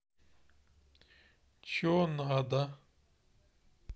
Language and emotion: Russian, sad